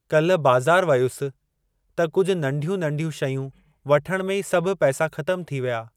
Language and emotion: Sindhi, neutral